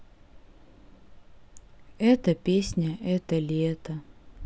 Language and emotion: Russian, sad